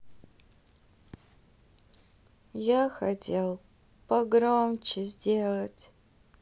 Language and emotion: Russian, sad